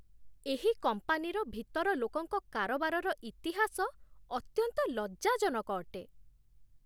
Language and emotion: Odia, disgusted